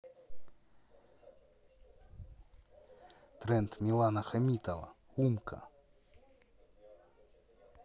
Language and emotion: Russian, neutral